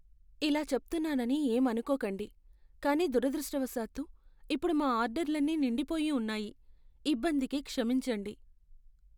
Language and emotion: Telugu, sad